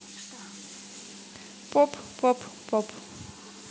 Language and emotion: Russian, neutral